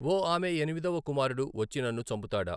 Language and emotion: Telugu, neutral